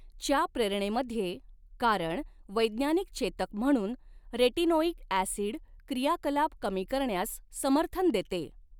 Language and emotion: Marathi, neutral